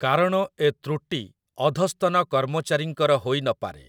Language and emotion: Odia, neutral